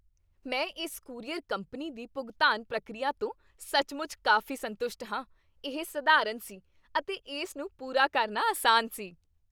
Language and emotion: Punjabi, happy